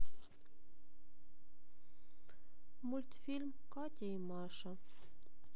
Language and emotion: Russian, sad